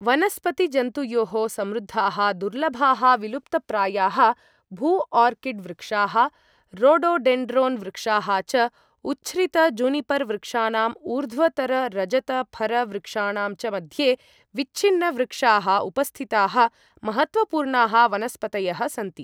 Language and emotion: Sanskrit, neutral